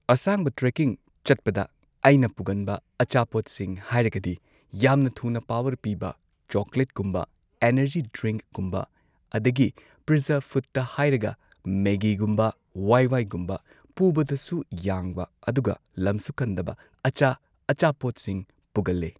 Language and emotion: Manipuri, neutral